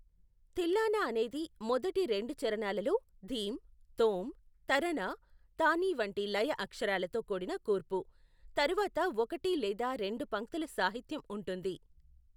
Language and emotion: Telugu, neutral